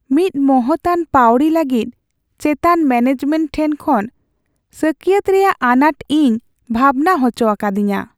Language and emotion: Santali, sad